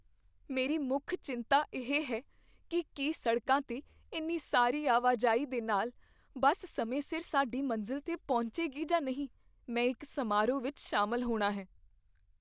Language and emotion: Punjabi, fearful